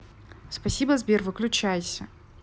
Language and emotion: Russian, angry